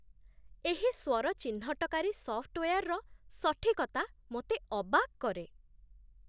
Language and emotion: Odia, surprised